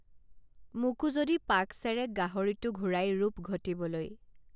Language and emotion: Assamese, neutral